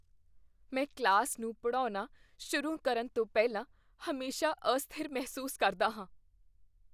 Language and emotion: Punjabi, fearful